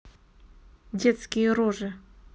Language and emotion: Russian, neutral